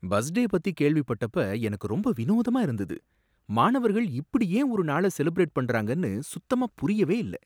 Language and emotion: Tamil, surprised